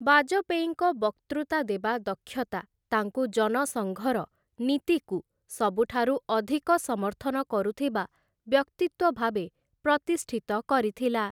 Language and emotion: Odia, neutral